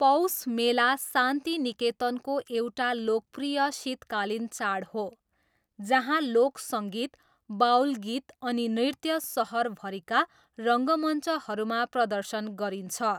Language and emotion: Nepali, neutral